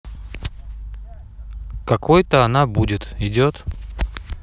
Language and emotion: Russian, neutral